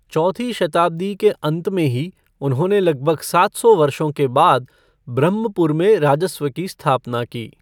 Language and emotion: Hindi, neutral